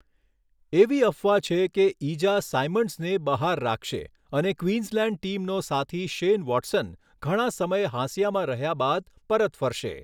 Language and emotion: Gujarati, neutral